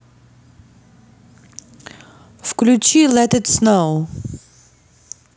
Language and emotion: Russian, neutral